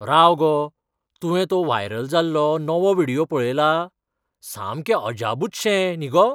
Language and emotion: Goan Konkani, surprised